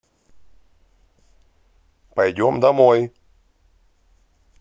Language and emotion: Russian, angry